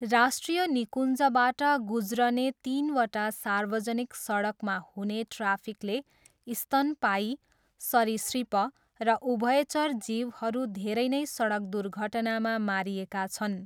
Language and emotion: Nepali, neutral